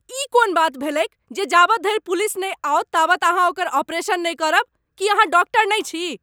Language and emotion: Maithili, angry